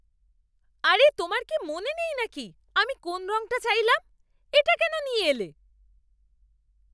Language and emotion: Bengali, angry